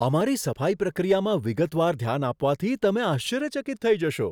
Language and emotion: Gujarati, surprised